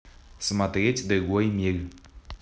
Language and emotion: Russian, neutral